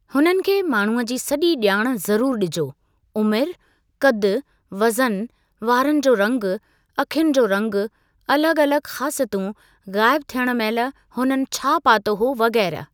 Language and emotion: Sindhi, neutral